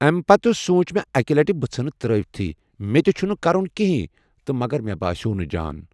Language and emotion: Kashmiri, neutral